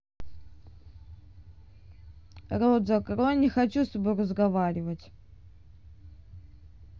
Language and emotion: Russian, neutral